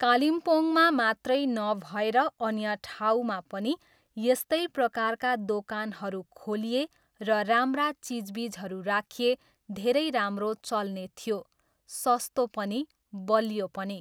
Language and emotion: Nepali, neutral